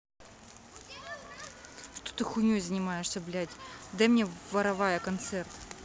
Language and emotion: Russian, angry